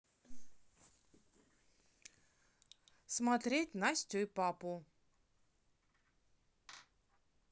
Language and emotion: Russian, neutral